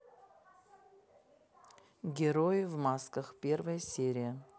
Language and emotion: Russian, neutral